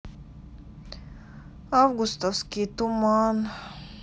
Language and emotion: Russian, sad